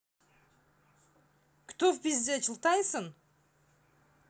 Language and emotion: Russian, angry